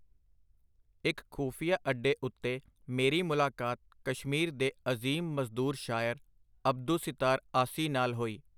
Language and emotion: Punjabi, neutral